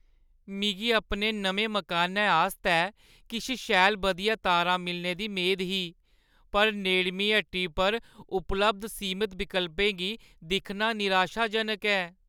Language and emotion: Dogri, sad